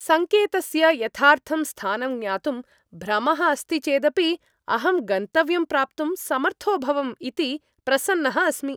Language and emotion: Sanskrit, happy